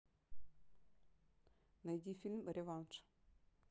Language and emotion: Russian, neutral